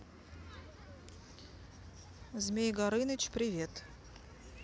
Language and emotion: Russian, neutral